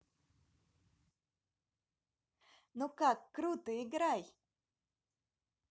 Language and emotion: Russian, positive